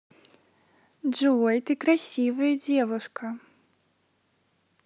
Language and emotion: Russian, positive